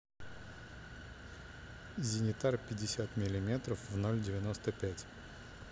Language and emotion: Russian, neutral